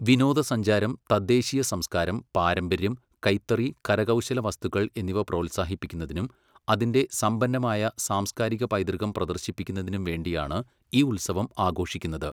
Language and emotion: Malayalam, neutral